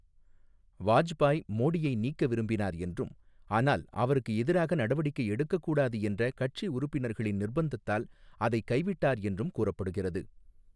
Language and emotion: Tamil, neutral